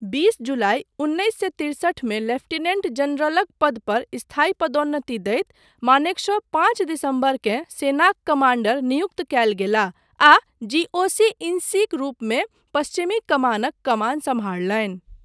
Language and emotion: Maithili, neutral